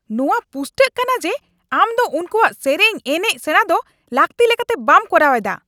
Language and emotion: Santali, angry